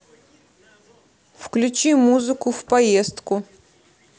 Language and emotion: Russian, neutral